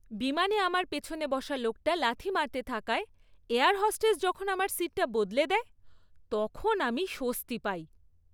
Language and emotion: Bengali, happy